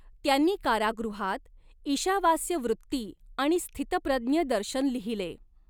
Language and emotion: Marathi, neutral